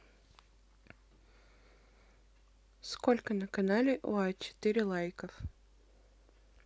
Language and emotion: Russian, neutral